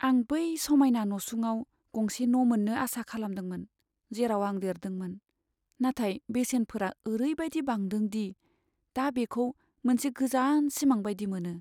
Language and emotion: Bodo, sad